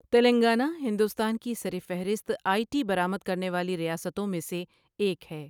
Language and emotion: Urdu, neutral